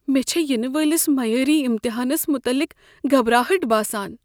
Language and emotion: Kashmiri, fearful